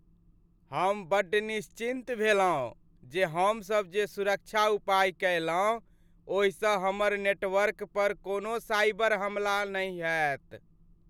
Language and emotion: Maithili, happy